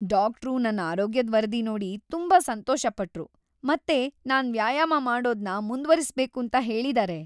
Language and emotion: Kannada, happy